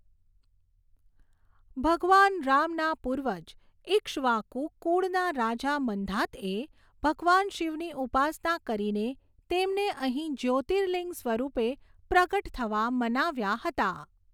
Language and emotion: Gujarati, neutral